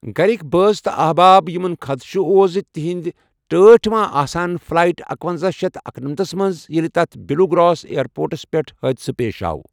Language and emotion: Kashmiri, neutral